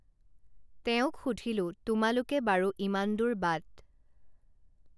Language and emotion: Assamese, neutral